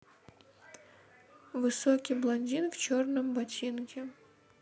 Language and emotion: Russian, neutral